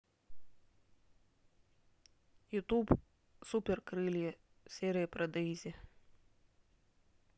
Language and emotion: Russian, neutral